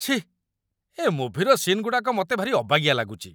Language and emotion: Odia, disgusted